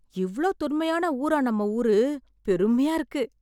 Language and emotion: Tamil, surprised